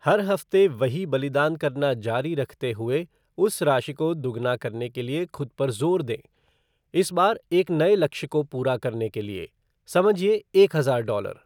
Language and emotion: Hindi, neutral